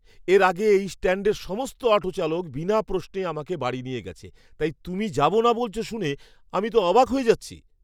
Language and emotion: Bengali, surprised